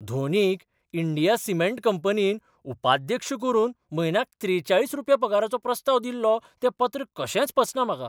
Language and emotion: Goan Konkani, surprised